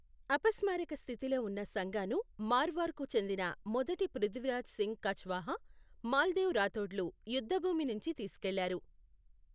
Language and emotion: Telugu, neutral